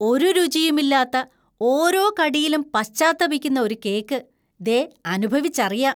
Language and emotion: Malayalam, disgusted